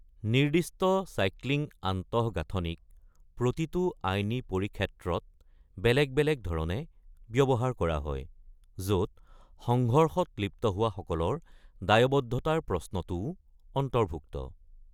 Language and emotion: Assamese, neutral